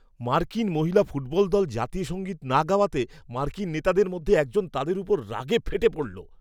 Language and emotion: Bengali, angry